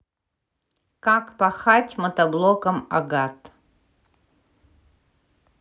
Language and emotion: Russian, neutral